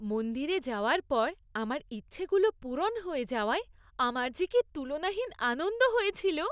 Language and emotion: Bengali, happy